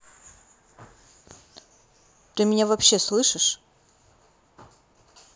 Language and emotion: Russian, angry